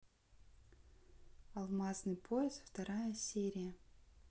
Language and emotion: Russian, neutral